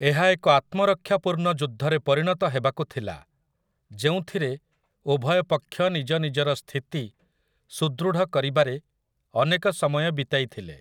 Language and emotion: Odia, neutral